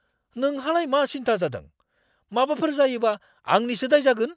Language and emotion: Bodo, angry